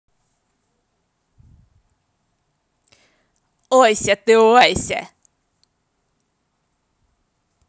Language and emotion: Russian, positive